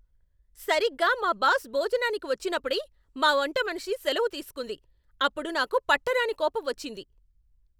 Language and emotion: Telugu, angry